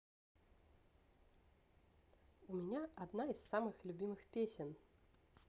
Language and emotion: Russian, positive